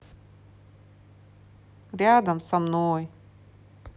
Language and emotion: Russian, sad